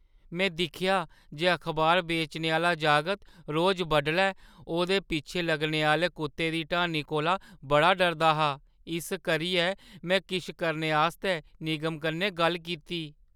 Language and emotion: Dogri, fearful